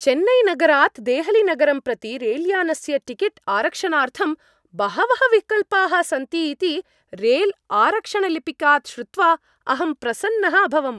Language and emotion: Sanskrit, happy